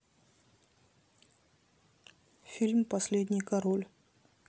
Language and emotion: Russian, neutral